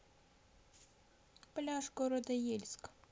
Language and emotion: Russian, neutral